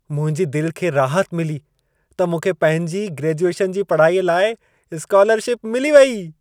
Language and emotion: Sindhi, happy